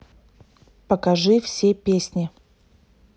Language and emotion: Russian, neutral